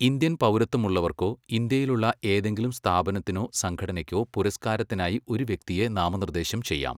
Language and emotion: Malayalam, neutral